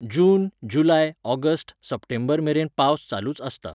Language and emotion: Goan Konkani, neutral